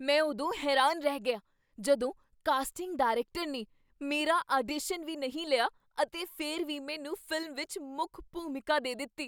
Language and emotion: Punjabi, surprised